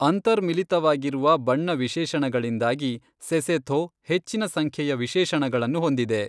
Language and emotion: Kannada, neutral